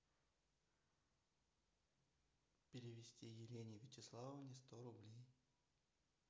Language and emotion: Russian, neutral